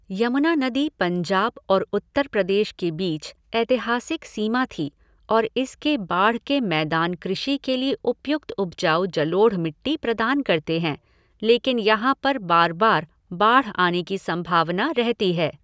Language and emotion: Hindi, neutral